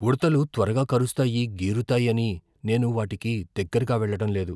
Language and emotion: Telugu, fearful